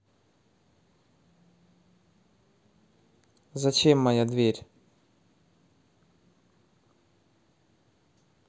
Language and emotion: Russian, neutral